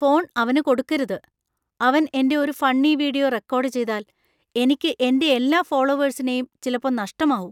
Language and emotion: Malayalam, fearful